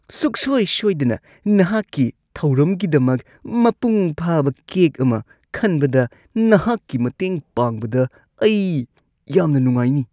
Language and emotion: Manipuri, disgusted